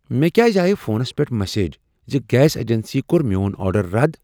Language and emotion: Kashmiri, surprised